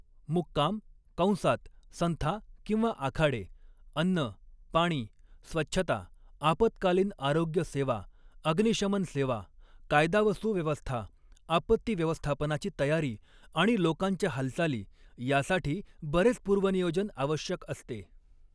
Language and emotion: Marathi, neutral